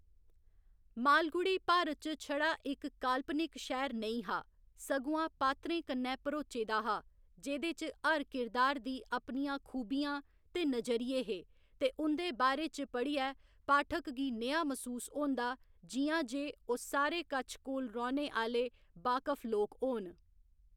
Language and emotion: Dogri, neutral